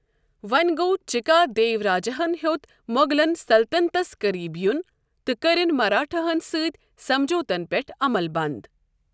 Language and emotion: Kashmiri, neutral